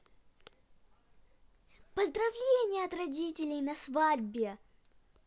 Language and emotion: Russian, positive